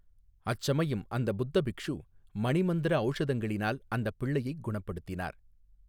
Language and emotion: Tamil, neutral